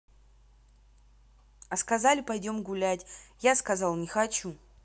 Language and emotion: Russian, neutral